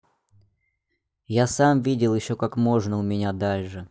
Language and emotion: Russian, neutral